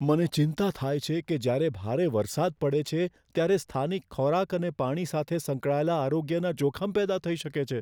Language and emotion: Gujarati, fearful